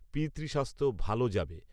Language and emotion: Bengali, neutral